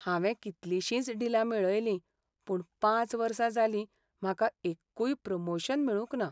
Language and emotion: Goan Konkani, sad